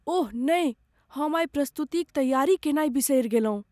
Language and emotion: Maithili, fearful